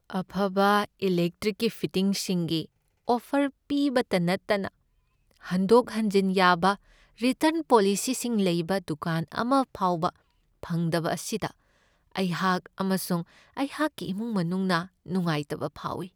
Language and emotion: Manipuri, sad